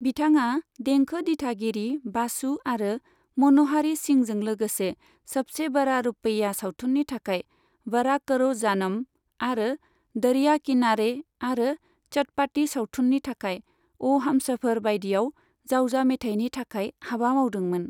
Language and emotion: Bodo, neutral